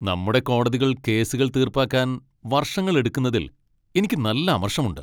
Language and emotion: Malayalam, angry